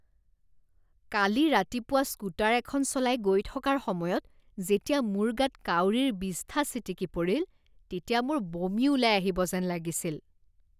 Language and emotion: Assamese, disgusted